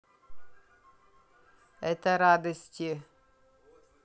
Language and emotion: Russian, neutral